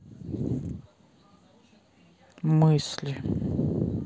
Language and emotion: Russian, neutral